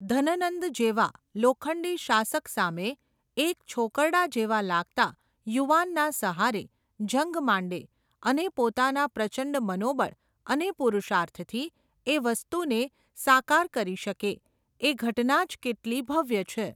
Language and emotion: Gujarati, neutral